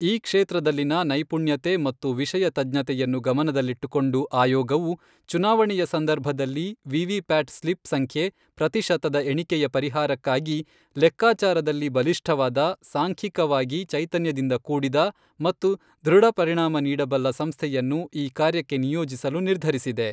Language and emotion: Kannada, neutral